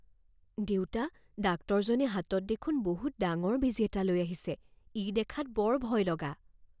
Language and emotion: Assamese, fearful